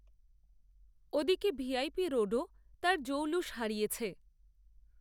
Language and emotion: Bengali, neutral